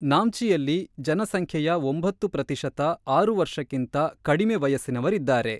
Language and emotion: Kannada, neutral